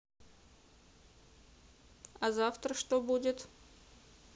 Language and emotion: Russian, neutral